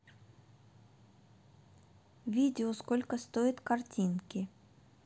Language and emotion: Russian, neutral